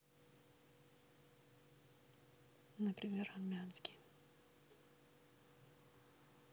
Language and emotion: Russian, neutral